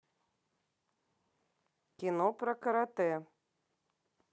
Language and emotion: Russian, neutral